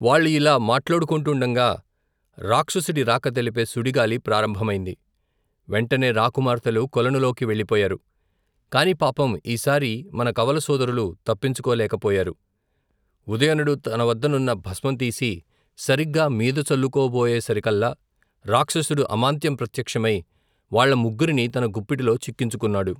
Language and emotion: Telugu, neutral